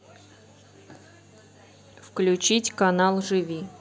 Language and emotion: Russian, neutral